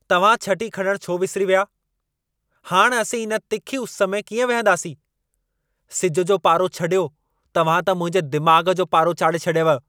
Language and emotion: Sindhi, angry